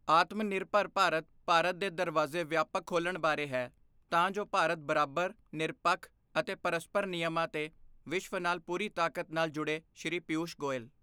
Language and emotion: Punjabi, neutral